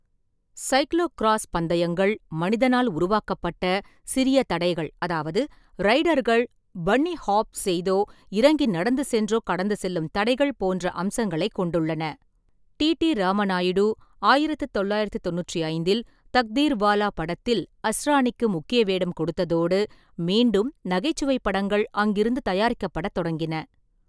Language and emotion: Tamil, neutral